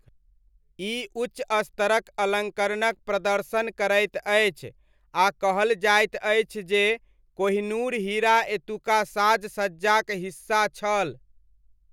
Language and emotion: Maithili, neutral